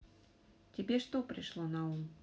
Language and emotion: Russian, neutral